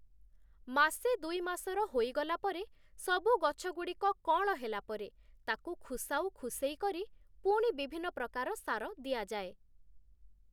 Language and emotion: Odia, neutral